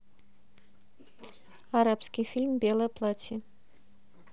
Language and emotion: Russian, neutral